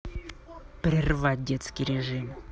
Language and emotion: Russian, angry